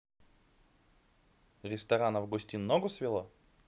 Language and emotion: Russian, positive